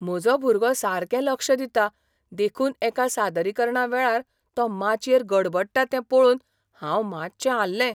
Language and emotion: Goan Konkani, surprised